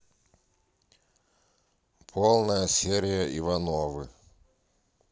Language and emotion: Russian, neutral